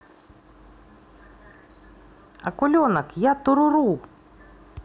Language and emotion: Russian, positive